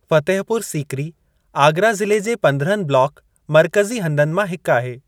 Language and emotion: Sindhi, neutral